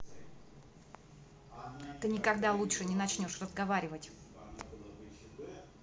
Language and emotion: Russian, angry